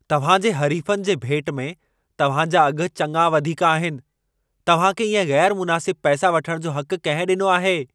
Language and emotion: Sindhi, angry